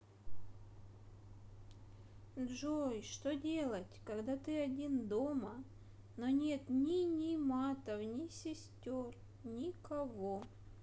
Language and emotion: Russian, sad